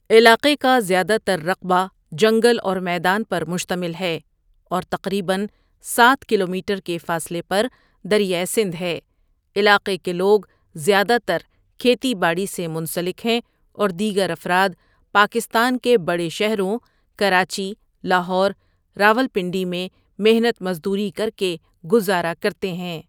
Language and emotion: Urdu, neutral